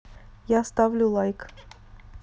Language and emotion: Russian, neutral